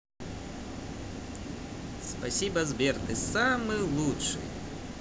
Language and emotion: Russian, positive